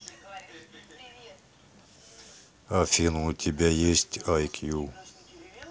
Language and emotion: Russian, neutral